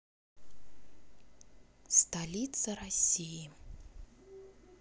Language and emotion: Russian, neutral